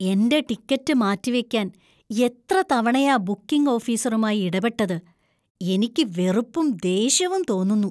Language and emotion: Malayalam, disgusted